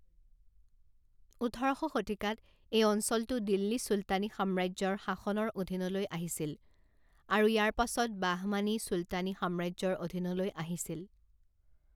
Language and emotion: Assamese, neutral